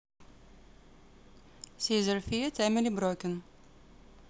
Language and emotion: Russian, neutral